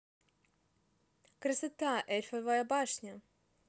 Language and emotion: Russian, positive